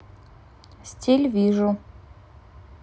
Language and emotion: Russian, neutral